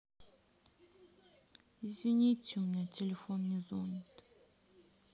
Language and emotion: Russian, sad